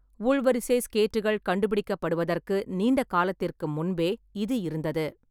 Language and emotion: Tamil, neutral